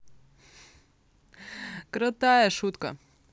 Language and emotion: Russian, positive